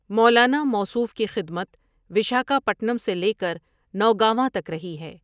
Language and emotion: Urdu, neutral